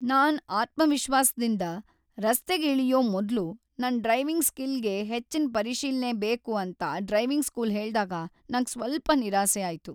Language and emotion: Kannada, sad